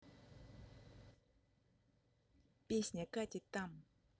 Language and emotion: Russian, neutral